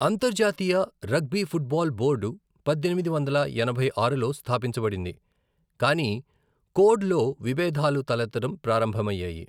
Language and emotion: Telugu, neutral